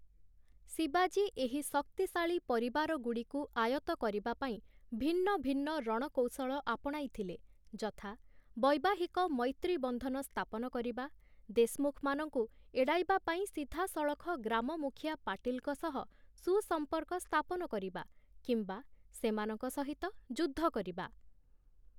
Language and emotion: Odia, neutral